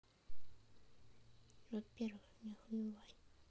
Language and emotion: Russian, neutral